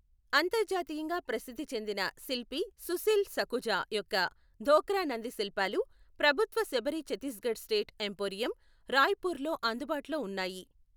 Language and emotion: Telugu, neutral